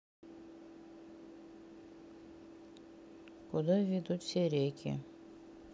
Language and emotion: Russian, neutral